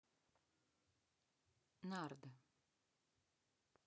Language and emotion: Russian, neutral